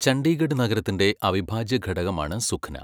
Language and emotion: Malayalam, neutral